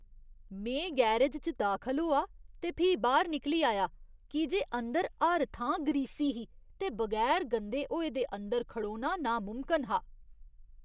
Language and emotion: Dogri, disgusted